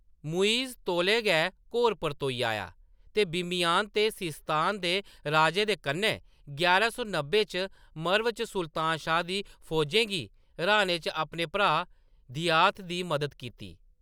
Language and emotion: Dogri, neutral